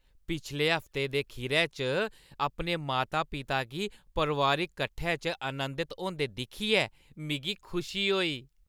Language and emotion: Dogri, happy